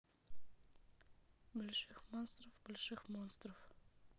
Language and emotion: Russian, neutral